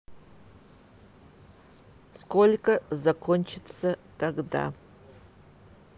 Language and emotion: Russian, neutral